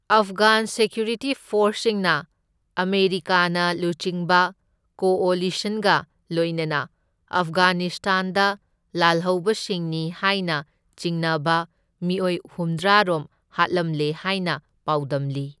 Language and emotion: Manipuri, neutral